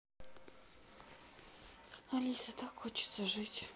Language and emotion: Russian, sad